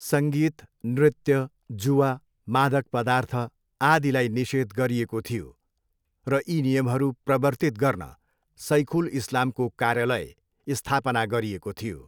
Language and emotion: Nepali, neutral